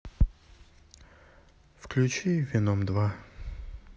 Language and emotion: Russian, sad